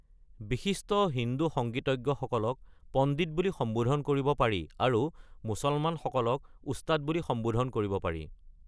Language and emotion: Assamese, neutral